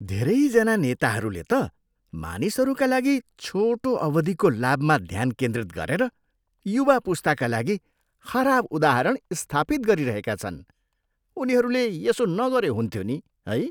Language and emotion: Nepali, disgusted